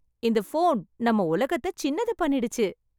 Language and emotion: Tamil, happy